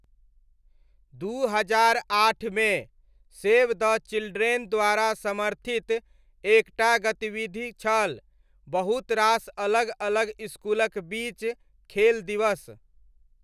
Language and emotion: Maithili, neutral